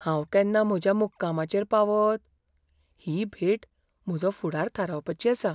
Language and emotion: Goan Konkani, fearful